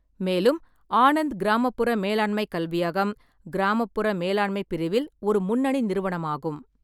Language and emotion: Tamil, neutral